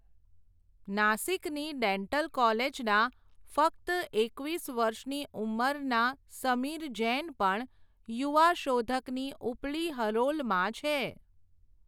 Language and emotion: Gujarati, neutral